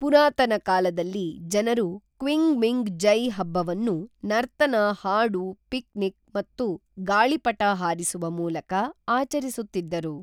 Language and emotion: Kannada, neutral